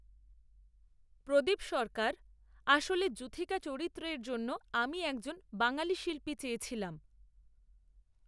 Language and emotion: Bengali, neutral